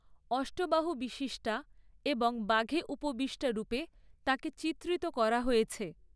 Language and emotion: Bengali, neutral